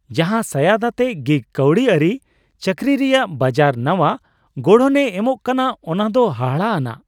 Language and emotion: Santali, surprised